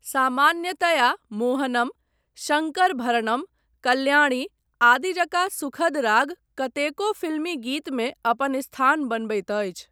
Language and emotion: Maithili, neutral